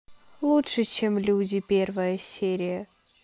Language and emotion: Russian, sad